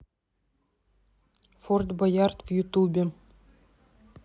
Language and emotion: Russian, neutral